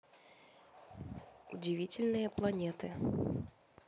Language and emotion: Russian, neutral